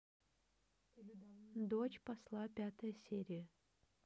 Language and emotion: Russian, neutral